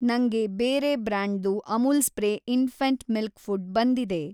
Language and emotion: Kannada, neutral